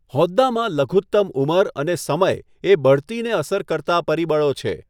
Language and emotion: Gujarati, neutral